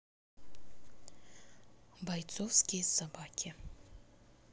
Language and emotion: Russian, neutral